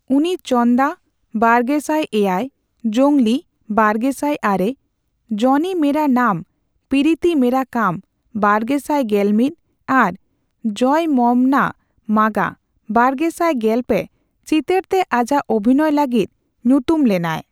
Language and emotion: Santali, neutral